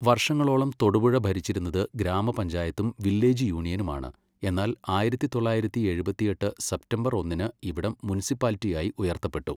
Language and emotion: Malayalam, neutral